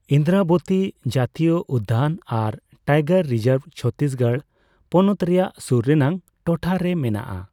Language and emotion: Santali, neutral